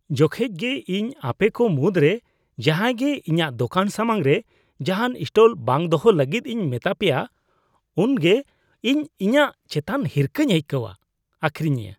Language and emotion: Santali, disgusted